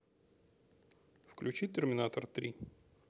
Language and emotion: Russian, neutral